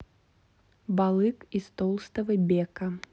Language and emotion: Russian, neutral